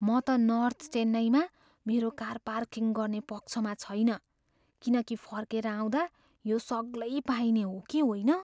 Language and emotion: Nepali, fearful